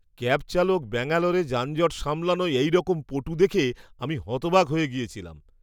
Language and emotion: Bengali, surprised